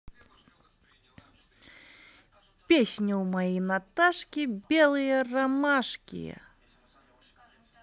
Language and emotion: Russian, positive